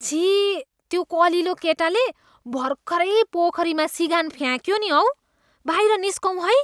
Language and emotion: Nepali, disgusted